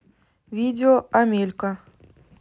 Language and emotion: Russian, neutral